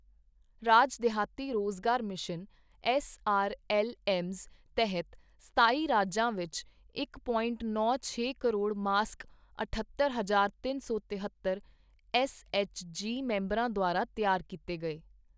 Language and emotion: Punjabi, neutral